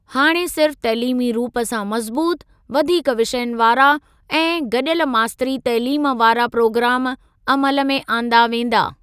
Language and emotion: Sindhi, neutral